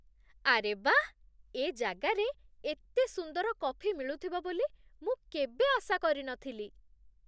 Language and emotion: Odia, surprised